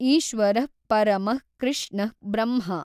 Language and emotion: Kannada, neutral